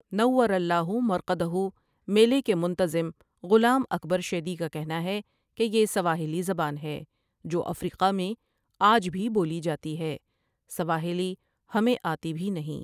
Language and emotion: Urdu, neutral